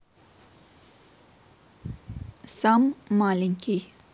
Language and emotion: Russian, neutral